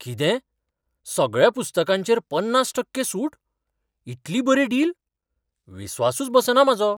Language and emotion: Goan Konkani, surprised